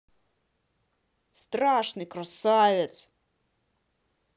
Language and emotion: Russian, angry